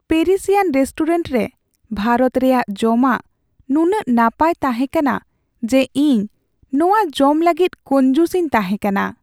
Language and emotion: Santali, sad